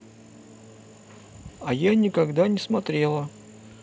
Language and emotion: Russian, neutral